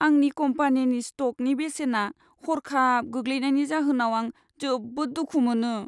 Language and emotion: Bodo, sad